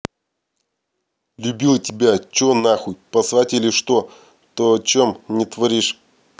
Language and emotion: Russian, angry